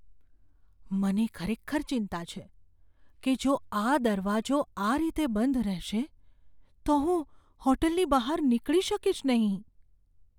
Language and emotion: Gujarati, fearful